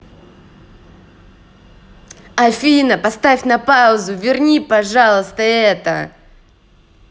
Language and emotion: Russian, angry